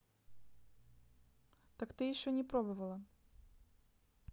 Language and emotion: Russian, neutral